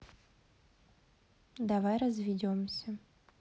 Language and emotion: Russian, sad